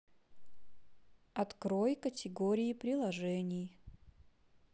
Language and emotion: Russian, neutral